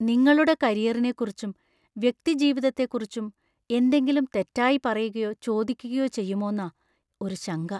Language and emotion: Malayalam, fearful